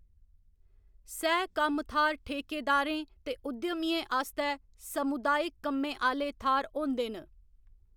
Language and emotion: Dogri, neutral